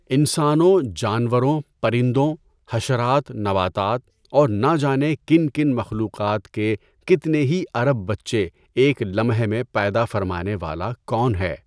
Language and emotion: Urdu, neutral